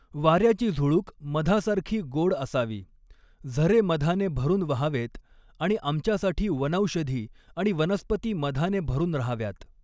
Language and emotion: Marathi, neutral